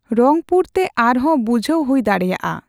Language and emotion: Santali, neutral